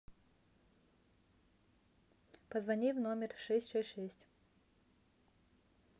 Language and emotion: Russian, neutral